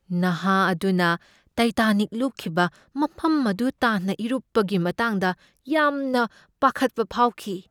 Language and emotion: Manipuri, fearful